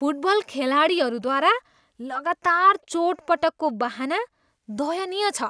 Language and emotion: Nepali, disgusted